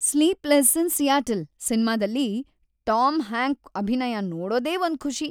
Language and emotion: Kannada, happy